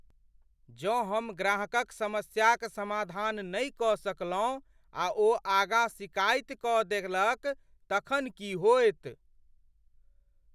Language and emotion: Maithili, fearful